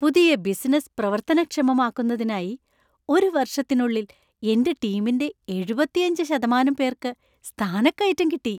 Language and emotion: Malayalam, happy